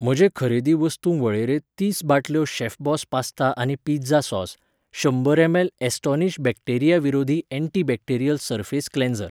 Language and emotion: Goan Konkani, neutral